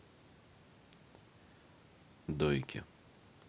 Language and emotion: Russian, neutral